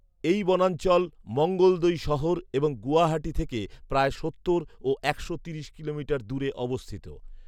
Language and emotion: Bengali, neutral